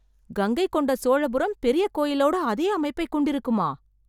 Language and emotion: Tamil, surprised